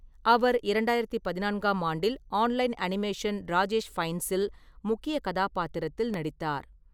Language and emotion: Tamil, neutral